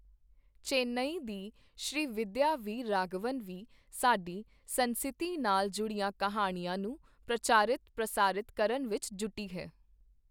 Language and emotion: Punjabi, neutral